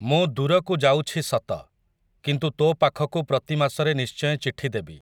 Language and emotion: Odia, neutral